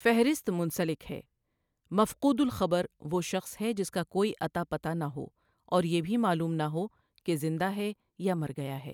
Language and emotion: Urdu, neutral